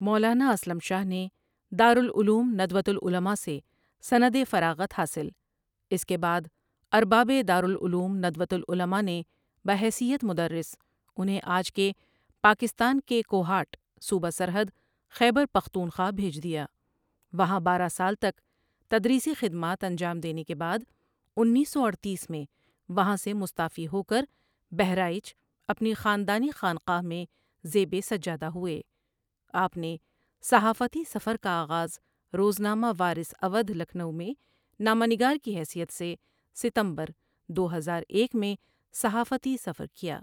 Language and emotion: Urdu, neutral